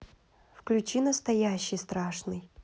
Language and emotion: Russian, neutral